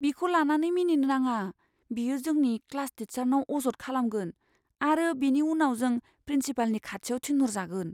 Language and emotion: Bodo, fearful